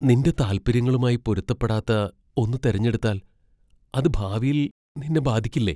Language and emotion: Malayalam, fearful